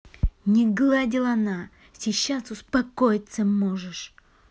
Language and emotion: Russian, angry